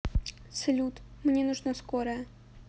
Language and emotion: Russian, neutral